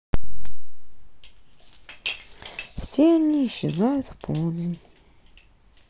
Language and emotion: Russian, sad